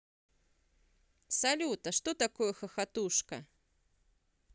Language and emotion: Russian, neutral